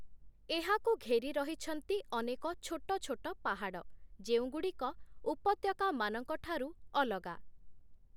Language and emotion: Odia, neutral